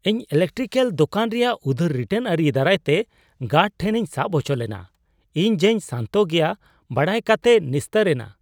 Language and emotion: Santali, surprised